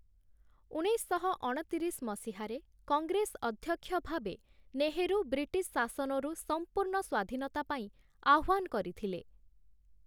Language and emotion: Odia, neutral